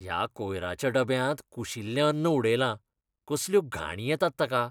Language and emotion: Goan Konkani, disgusted